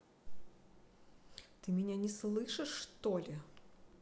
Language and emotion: Russian, neutral